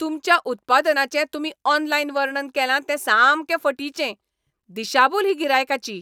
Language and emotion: Goan Konkani, angry